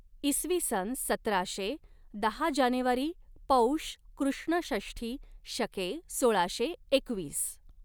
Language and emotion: Marathi, neutral